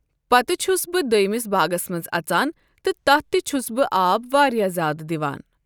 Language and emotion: Kashmiri, neutral